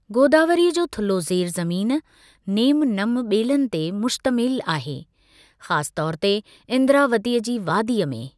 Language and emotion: Sindhi, neutral